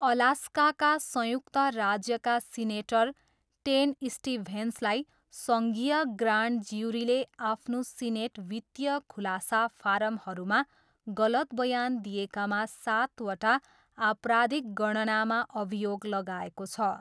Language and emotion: Nepali, neutral